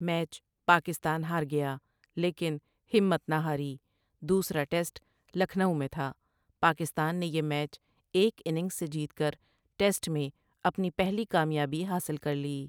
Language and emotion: Urdu, neutral